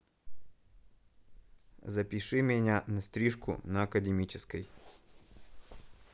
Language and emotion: Russian, neutral